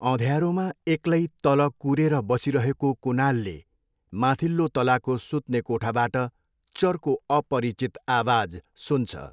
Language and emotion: Nepali, neutral